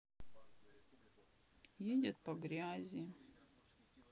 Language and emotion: Russian, sad